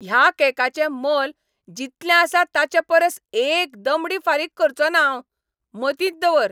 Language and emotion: Goan Konkani, angry